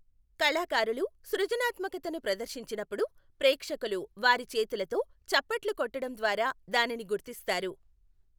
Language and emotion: Telugu, neutral